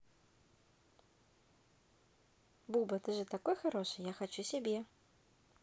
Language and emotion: Russian, positive